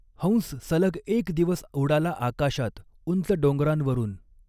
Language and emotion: Marathi, neutral